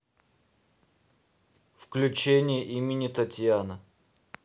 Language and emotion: Russian, neutral